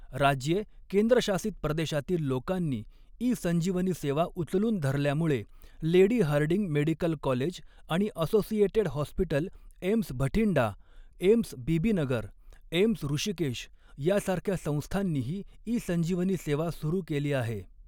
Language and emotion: Marathi, neutral